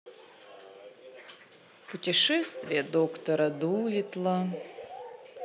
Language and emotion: Russian, sad